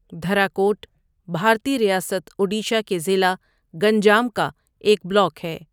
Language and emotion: Urdu, neutral